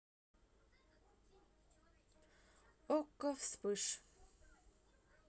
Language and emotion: Russian, neutral